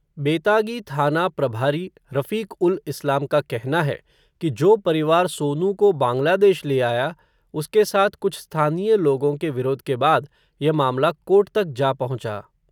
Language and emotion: Hindi, neutral